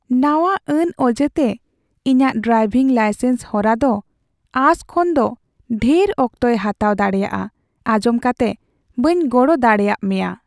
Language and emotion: Santali, sad